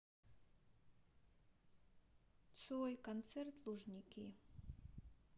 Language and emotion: Russian, sad